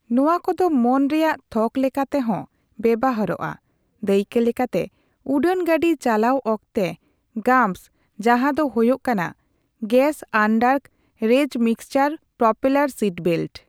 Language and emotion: Santali, neutral